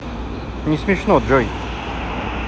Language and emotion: Russian, neutral